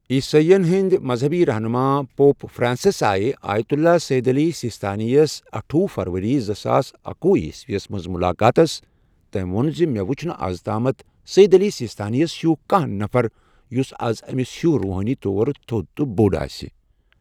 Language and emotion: Kashmiri, neutral